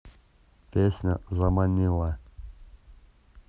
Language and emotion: Russian, neutral